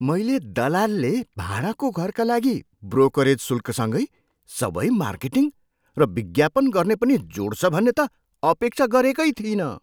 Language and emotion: Nepali, surprised